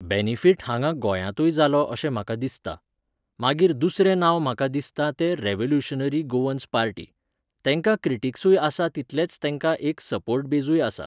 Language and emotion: Goan Konkani, neutral